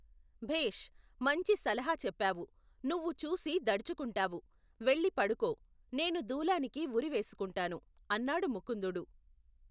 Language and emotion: Telugu, neutral